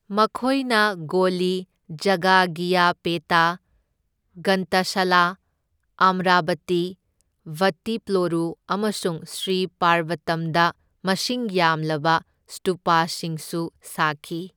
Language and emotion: Manipuri, neutral